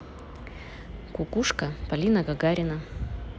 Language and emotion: Russian, neutral